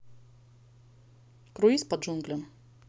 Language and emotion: Russian, neutral